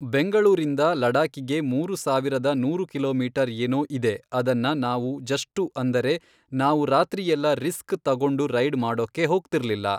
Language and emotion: Kannada, neutral